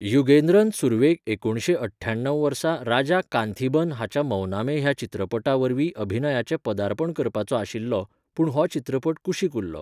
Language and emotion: Goan Konkani, neutral